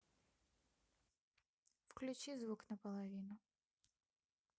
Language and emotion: Russian, neutral